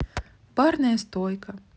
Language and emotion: Russian, neutral